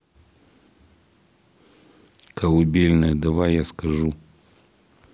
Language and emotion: Russian, neutral